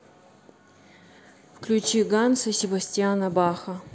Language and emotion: Russian, neutral